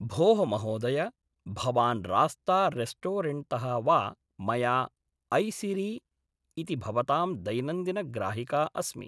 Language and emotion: Sanskrit, neutral